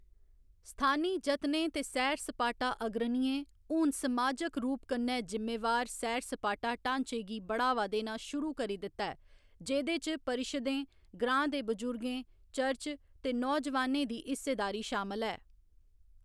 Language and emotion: Dogri, neutral